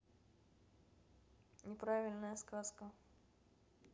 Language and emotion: Russian, neutral